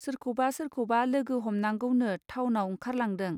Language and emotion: Bodo, neutral